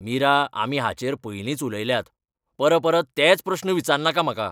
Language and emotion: Goan Konkani, angry